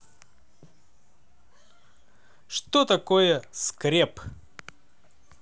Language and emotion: Russian, positive